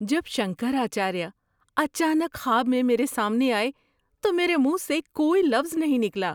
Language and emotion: Urdu, surprised